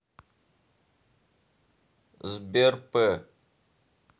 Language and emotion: Russian, neutral